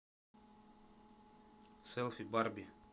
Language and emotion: Russian, neutral